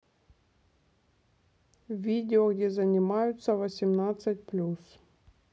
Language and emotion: Russian, neutral